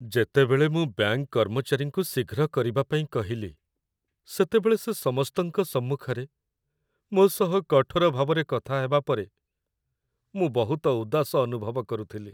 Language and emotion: Odia, sad